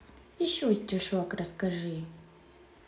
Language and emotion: Russian, neutral